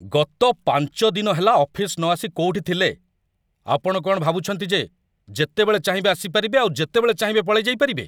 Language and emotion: Odia, angry